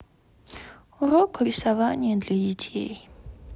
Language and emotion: Russian, sad